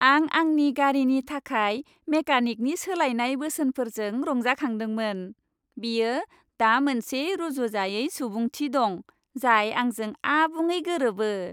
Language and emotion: Bodo, happy